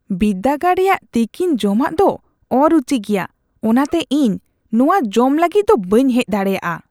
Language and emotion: Santali, disgusted